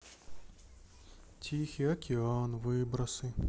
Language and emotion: Russian, sad